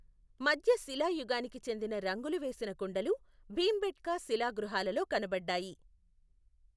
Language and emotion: Telugu, neutral